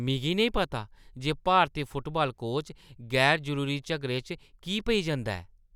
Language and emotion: Dogri, disgusted